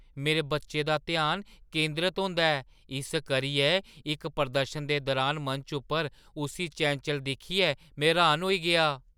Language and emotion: Dogri, surprised